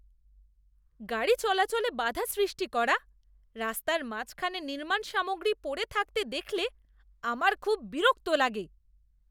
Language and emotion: Bengali, disgusted